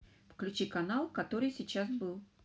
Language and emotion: Russian, neutral